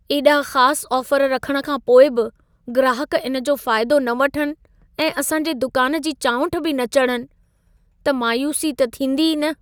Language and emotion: Sindhi, sad